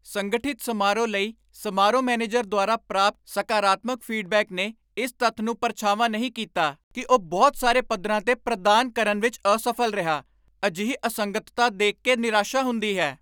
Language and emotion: Punjabi, angry